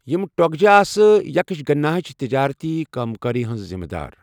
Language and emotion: Kashmiri, neutral